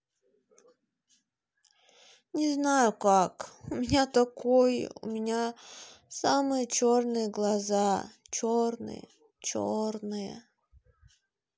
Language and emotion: Russian, sad